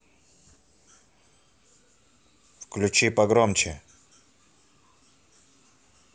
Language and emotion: Russian, angry